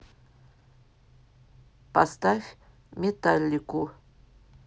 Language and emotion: Russian, neutral